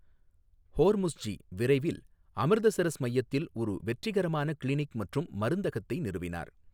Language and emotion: Tamil, neutral